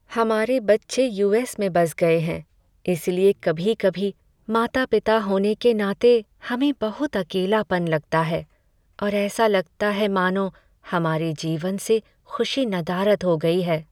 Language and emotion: Hindi, sad